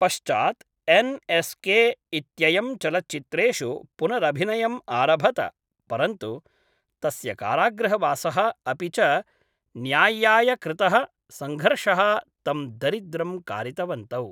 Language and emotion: Sanskrit, neutral